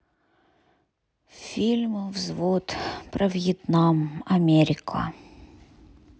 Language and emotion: Russian, sad